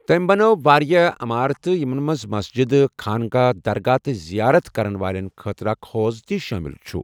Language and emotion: Kashmiri, neutral